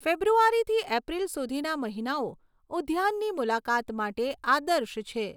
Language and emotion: Gujarati, neutral